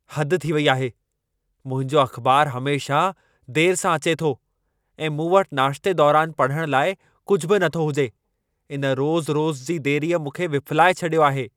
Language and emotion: Sindhi, angry